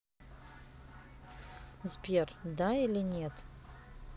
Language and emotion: Russian, neutral